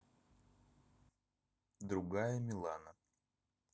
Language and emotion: Russian, neutral